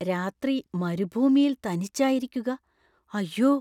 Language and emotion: Malayalam, fearful